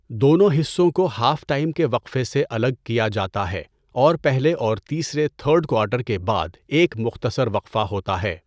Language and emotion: Urdu, neutral